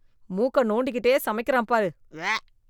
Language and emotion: Tamil, disgusted